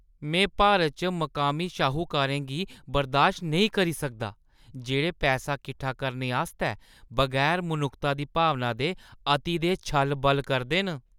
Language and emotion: Dogri, disgusted